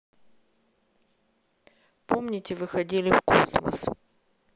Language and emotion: Russian, neutral